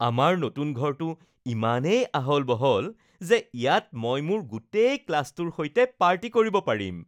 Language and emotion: Assamese, happy